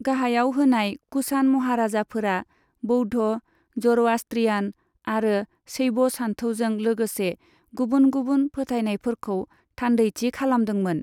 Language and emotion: Bodo, neutral